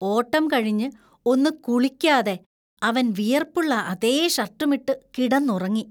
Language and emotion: Malayalam, disgusted